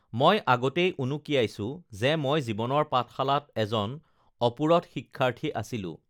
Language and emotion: Assamese, neutral